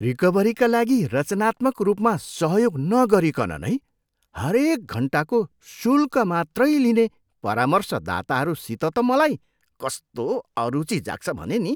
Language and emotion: Nepali, disgusted